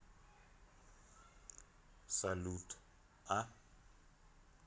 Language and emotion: Russian, neutral